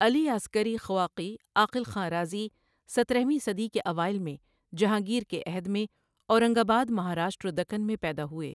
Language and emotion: Urdu, neutral